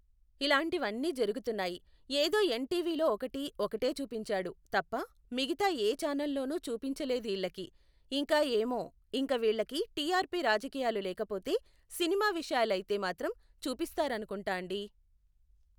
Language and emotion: Telugu, neutral